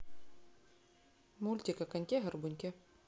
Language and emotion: Russian, neutral